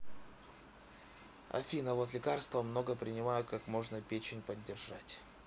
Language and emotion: Russian, neutral